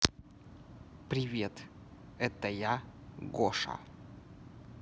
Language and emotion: Russian, neutral